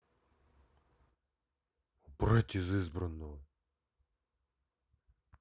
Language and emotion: Russian, angry